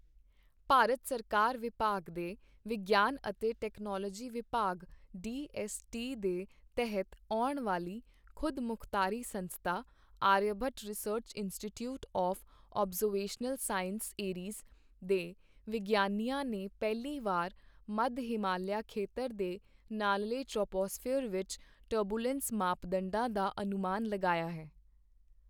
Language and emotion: Punjabi, neutral